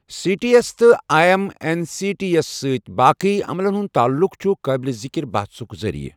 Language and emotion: Kashmiri, neutral